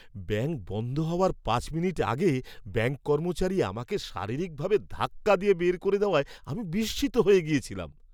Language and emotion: Bengali, surprised